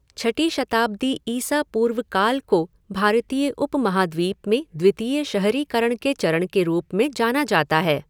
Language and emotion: Hindi, neutral